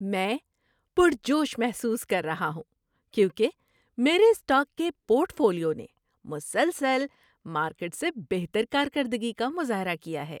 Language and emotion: Urdu, happy